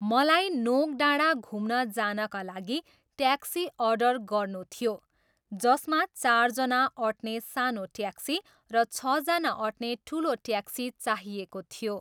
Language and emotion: Nepali, neutral